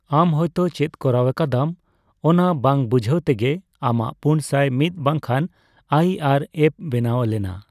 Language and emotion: Santali, neutral